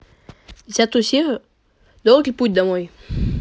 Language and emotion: Russian, neutral